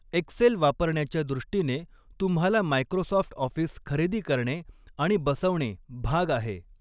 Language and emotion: Marathi, neutral